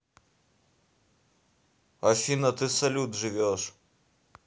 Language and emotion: Russian, neutral